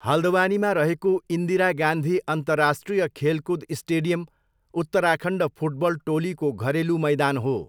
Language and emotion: Nepali, neutral